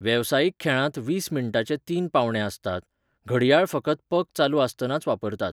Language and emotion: Goan Konkani, neutral